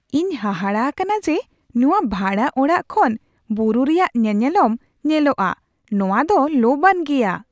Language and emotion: Santali, surprised